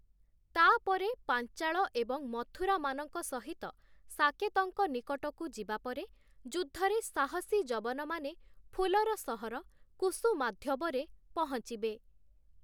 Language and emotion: Odia, neutral